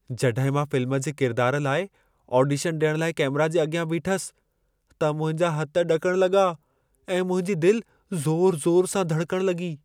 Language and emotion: Sindhi, fearful